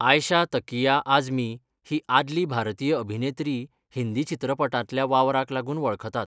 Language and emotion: Goan Konkani, neutral